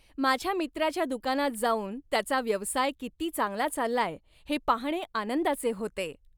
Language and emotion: Marathi, happy